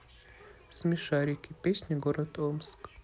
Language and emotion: Russian, neutral